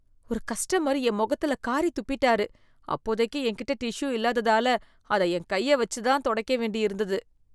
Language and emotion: Tamil, disgusted